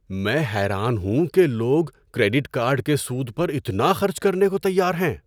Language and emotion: Urdu, surprised